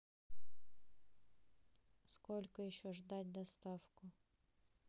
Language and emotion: Russian, neutral